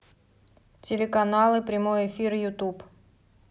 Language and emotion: Russian, neutral